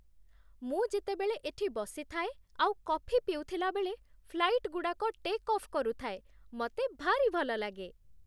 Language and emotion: Odia, happy